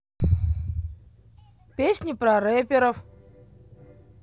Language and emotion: Russian, positive